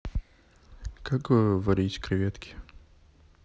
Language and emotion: Russian, neutral